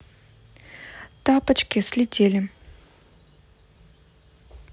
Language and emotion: Russian, neutral